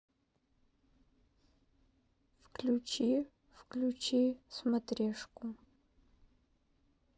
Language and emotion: Russian, sad